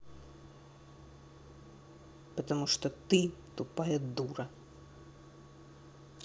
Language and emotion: Russian, angry